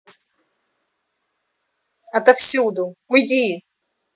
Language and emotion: Russian, angry